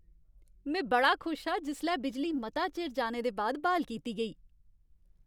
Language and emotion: Dogri, happy